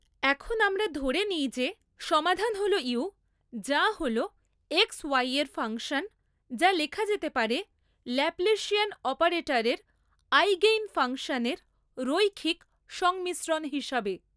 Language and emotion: Bengali, neutral